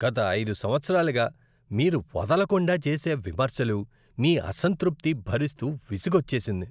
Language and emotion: Telugu, disgusted